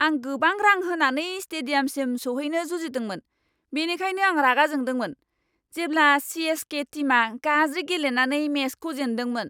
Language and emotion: Bodo, angry